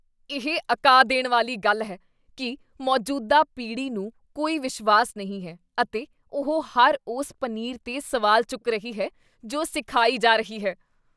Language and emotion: Punjabi, disgusted